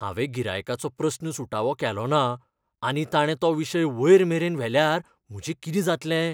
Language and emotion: Goan Konkani, fearful